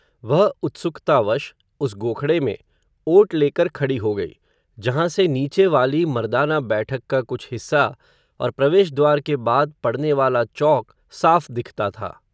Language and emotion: Hindi, neutral